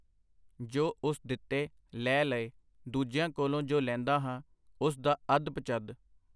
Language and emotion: Punjabi, neutral